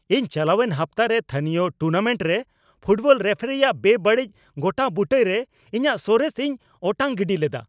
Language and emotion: Santali, angry